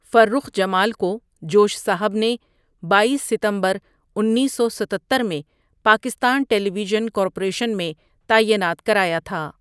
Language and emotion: Urdu, neutral